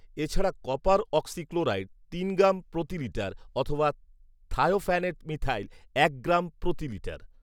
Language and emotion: Bengali, neutral